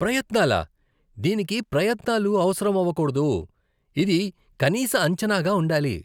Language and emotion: Telugu, disgusted